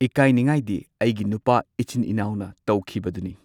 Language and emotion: Manipuri, neutral